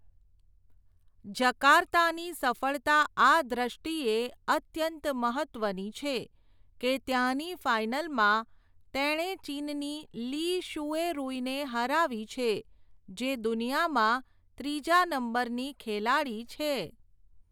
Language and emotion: Gujarati, neutral